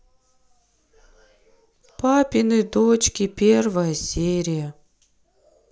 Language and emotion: Russian, sad